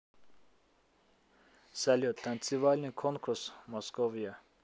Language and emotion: Russian, neutral